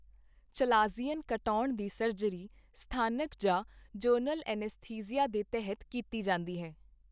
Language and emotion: Punjabi, neutral